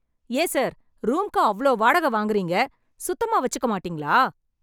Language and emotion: Tamil, angry